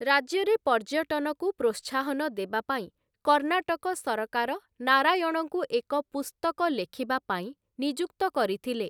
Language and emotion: Odia, neutral